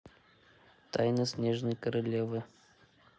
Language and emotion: Russian, neutral